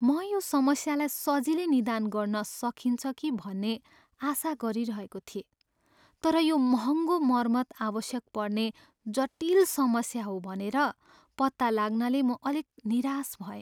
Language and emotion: Nepali, sad